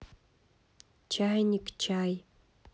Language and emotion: Russian, neutral